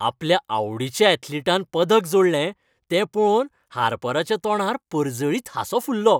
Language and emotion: Goan Konkani, happy